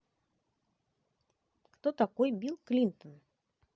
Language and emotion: Russian, neutral